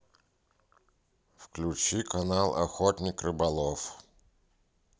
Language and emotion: Russian, neutral